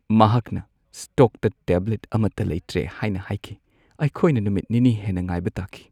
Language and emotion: Manipuri, sad